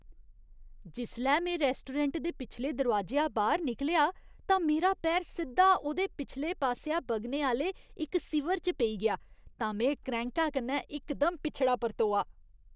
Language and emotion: Dogri, disgusted